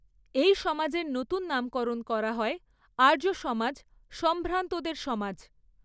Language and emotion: Bengali, neutral